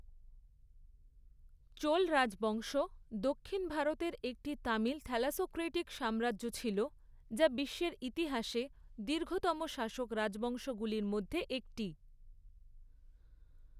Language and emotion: Bengali, neutral